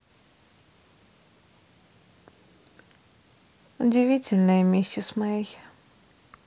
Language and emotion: Russian, sad